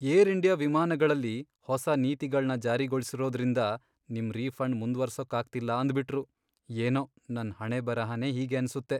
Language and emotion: Kannada, sad